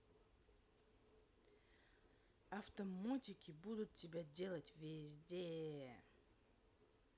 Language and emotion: Russian, angry